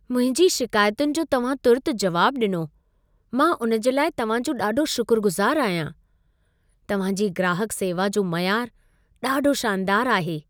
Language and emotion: Sindhi, happy